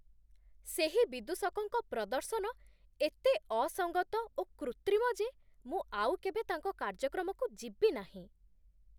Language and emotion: Odia, disgusted